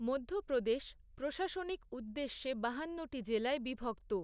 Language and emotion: Bengali, neutral